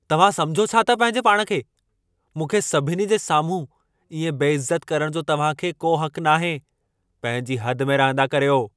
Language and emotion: Sindhi, angry